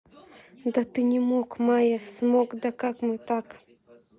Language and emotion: Russian, sad